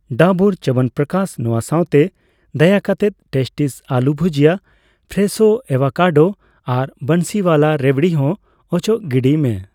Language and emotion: Santali, neutral